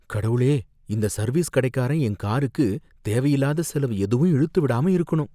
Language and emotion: Tamil, fearful